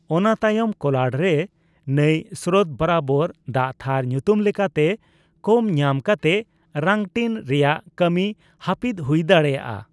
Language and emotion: Santali, neutral